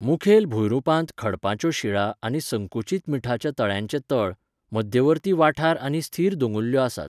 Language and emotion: Goan Konkani, neutral